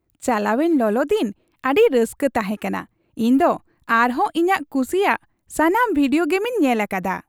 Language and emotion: Santali, happy